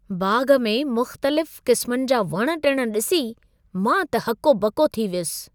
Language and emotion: Sindhi, surprised